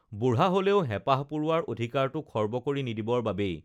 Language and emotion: Assamese, neutral